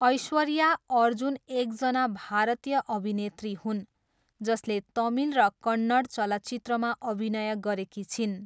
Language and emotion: Nepali, neutral